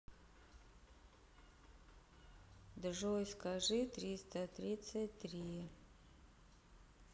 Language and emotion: Russian, neutral